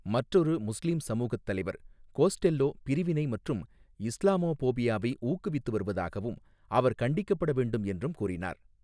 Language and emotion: Tamil, neutral